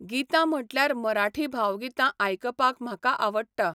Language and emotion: Goan Konkani, neutral